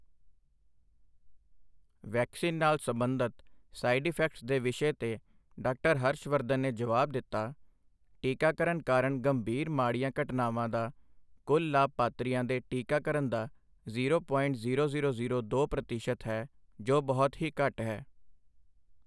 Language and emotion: Punjabi, neutral